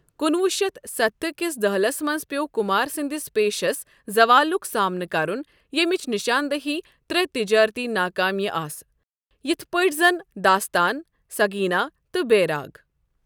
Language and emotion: Kashmiri, neutral